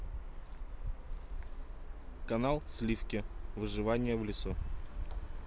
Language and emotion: Russian, neutral